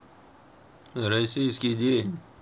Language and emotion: Russian, neutral